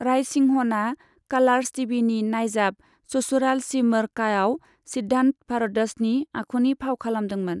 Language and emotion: Bodo, neutral